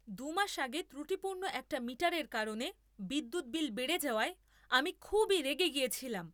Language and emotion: Bengali, angry